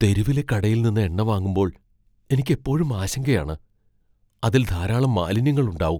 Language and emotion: Malayalam, fearful